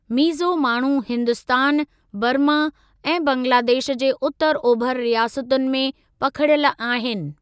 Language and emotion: Sindhi, neutral